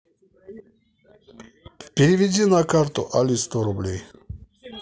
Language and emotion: Russian, neutral